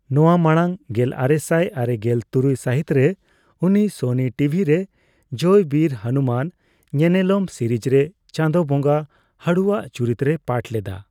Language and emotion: Santali, neutral